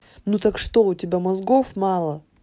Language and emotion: Russian, angry